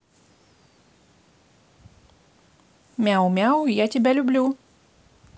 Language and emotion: Russian, positive